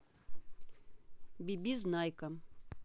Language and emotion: Russian, neutral